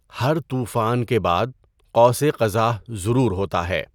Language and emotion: Urdu, neutral